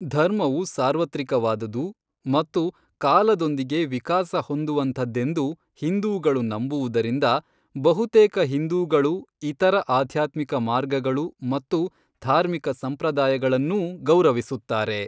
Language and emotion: Kannada, neutral